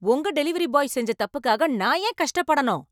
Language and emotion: Tamil, angry